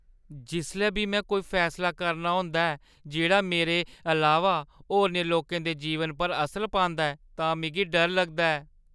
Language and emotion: Dogri, fearful